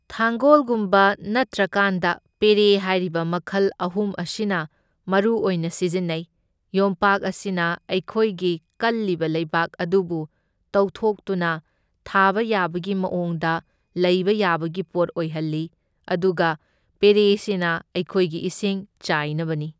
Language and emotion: Manipuri, neutral